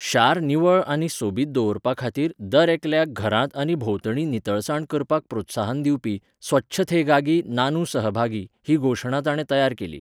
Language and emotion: Goan Konkani, neutral